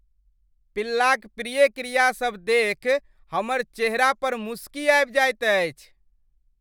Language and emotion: Maithili, happy